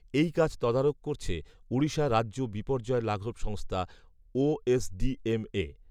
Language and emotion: Bengali, neutral